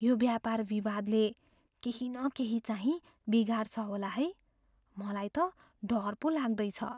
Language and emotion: Nepali, fearful